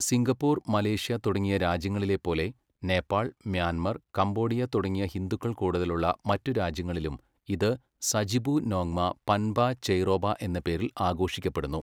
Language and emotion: Malayalam, neutral